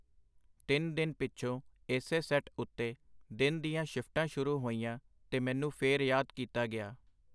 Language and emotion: Punjabi, neutral